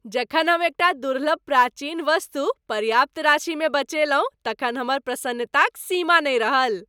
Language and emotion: Maithili, happy